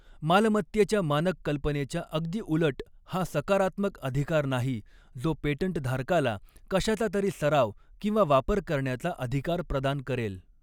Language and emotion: Marathi, neutral